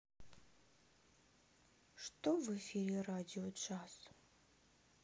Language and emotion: Russian, sad